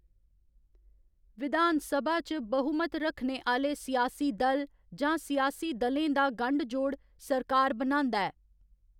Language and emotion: Dogri, neutral